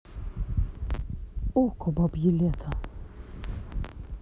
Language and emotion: Russian, neutral